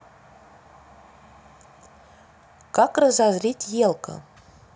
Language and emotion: Russian, neutral